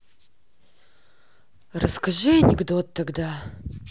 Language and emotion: Russian, neutral